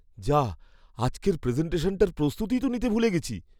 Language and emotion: Bengali, fearful